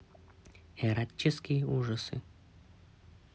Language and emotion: Russian, neutral